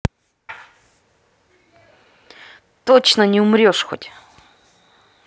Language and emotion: Russian, angry